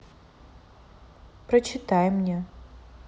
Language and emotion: Russian, neutral